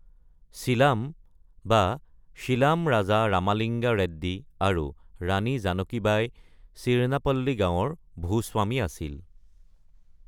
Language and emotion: Assamese, neutral